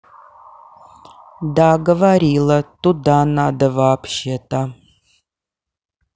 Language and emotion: Russian, neutral